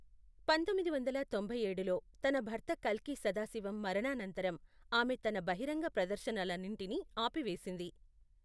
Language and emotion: Telugu, neutral